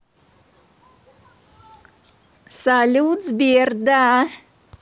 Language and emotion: Russian, positive